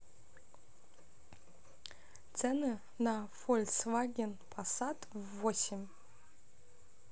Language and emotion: Russian, neutral